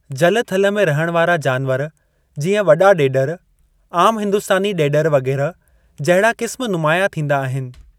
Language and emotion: Sindhi, neutral